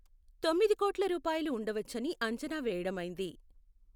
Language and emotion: Telugu, neutral